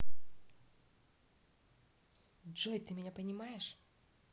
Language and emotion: Russian, neutral